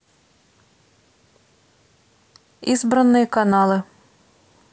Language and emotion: Russian, neutral